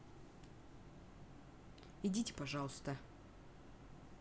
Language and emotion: Russian, neutral